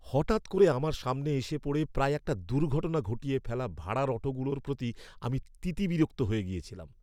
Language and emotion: Bengali, angry